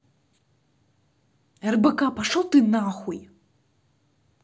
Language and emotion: Russian, angry